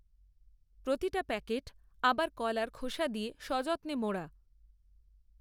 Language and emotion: Bengali, neutral